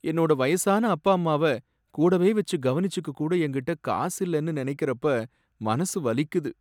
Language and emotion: Tamil, sad